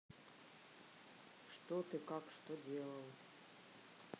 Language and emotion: Russian, neutral